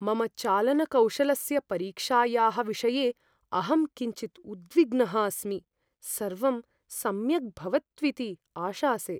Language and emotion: Sanskrit, fearful